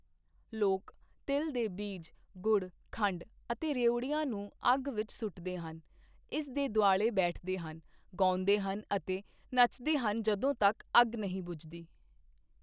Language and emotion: Punjabi, neutral